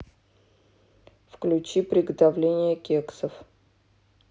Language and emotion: Russian, neutral